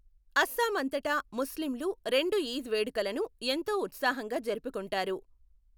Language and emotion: Telugu, neutral